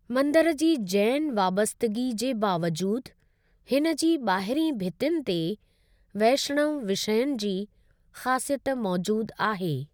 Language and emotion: Sindhi, neutral